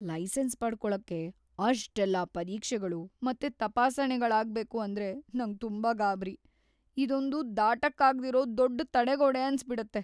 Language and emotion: Kannada, fearful